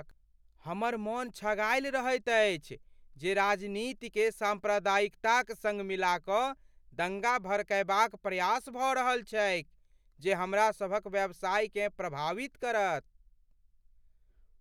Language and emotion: Maithili, fearful